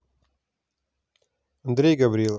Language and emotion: Russian, neutral